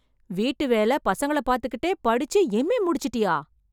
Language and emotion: Tamil, surprised